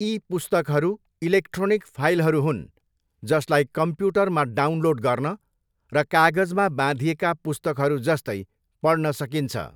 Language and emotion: Nepali, neutral